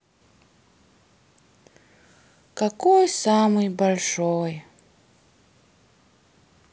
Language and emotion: Russian, sad